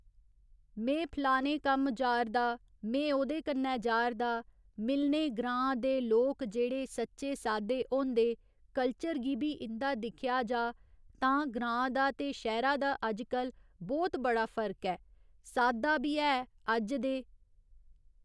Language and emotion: Dogri, neutral